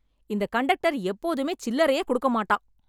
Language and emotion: Tamil, angry